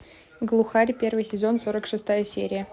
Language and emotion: Russian, neutral